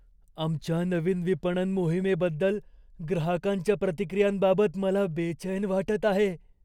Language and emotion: Marathi, fearful